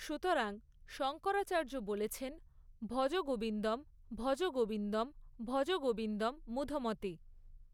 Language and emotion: Bengali, neutral